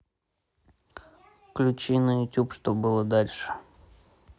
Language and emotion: Russian, neutral